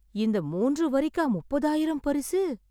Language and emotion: Tamil, surprised